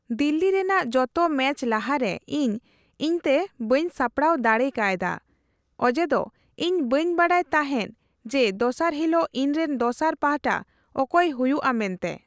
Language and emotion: Santali, neutral